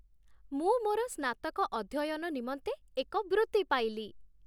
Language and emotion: Odia, happy